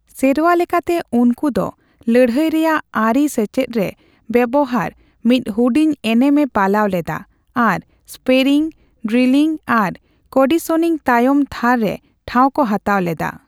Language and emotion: Santali, neutral